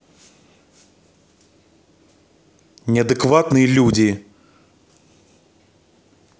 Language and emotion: Russian, angry